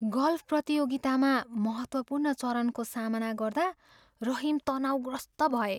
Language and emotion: Nepali, fearful